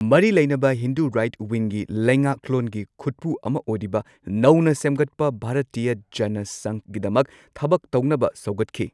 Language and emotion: Manipuri, neutral